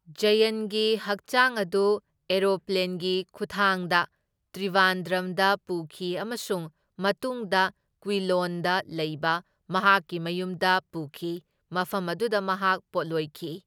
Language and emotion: Manipuri, neutral